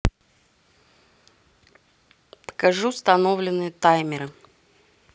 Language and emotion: Russian, neutral